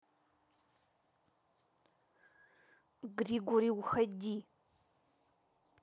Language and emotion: Russian, angry